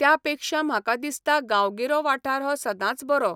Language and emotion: Goan Konkani, neutral